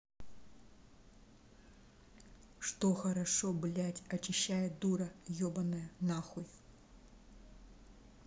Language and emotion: Russian, angry